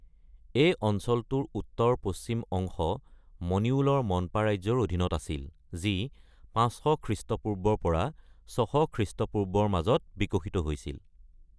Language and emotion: Assamese, neutral